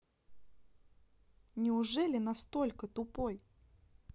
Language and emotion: Russian, neutral